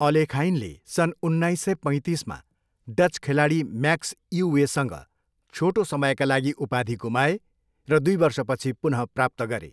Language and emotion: Nepali, neutral